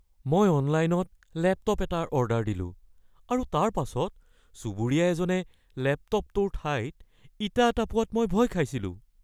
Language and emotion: Assamese, fearful